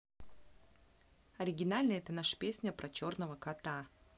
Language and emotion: Russian, neutral